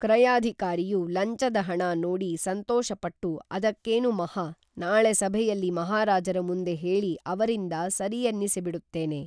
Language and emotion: Kannada, neutral